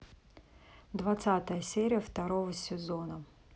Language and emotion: Russian, neutral